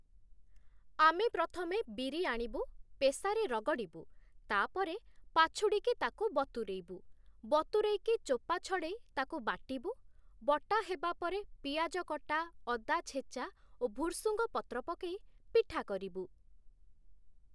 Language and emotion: Odia, neutral